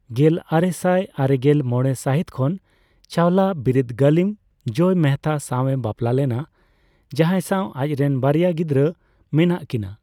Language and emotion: Santali, neutral